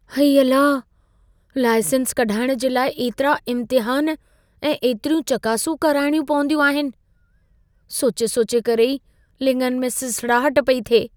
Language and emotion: Sindhi, fearful